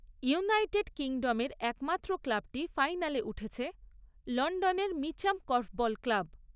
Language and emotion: Bengali, neutral